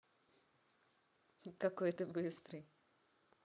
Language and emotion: Russian, positive